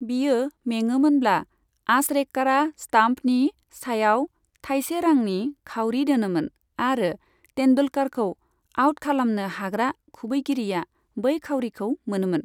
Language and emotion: Bodo, neutral